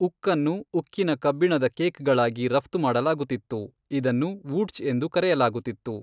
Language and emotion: Kannada, neutral